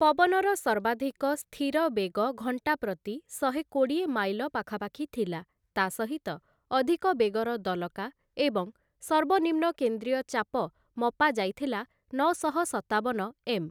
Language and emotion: Odia, neutral